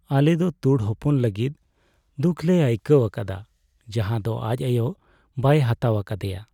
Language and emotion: Santali, sad